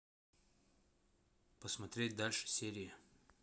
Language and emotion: Russian, neutral